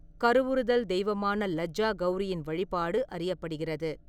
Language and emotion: Tamil, neutral